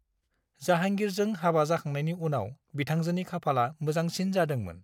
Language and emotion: Bodo, neutral